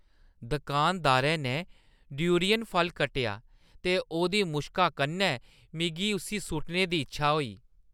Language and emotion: Dogri, disgusted